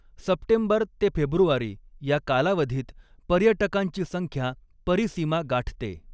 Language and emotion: Marathi, neutral